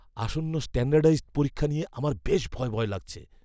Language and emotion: Bengali, fearful